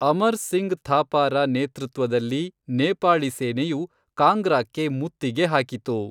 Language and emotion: Kannada, neutral